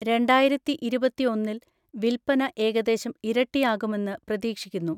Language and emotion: Malayalam, neutral